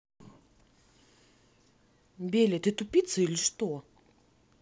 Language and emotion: Russian, angry